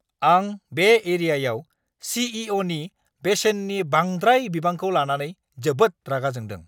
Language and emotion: Bodo, angry